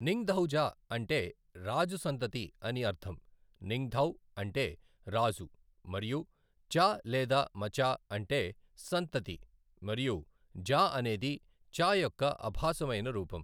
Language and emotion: Telugu, neutral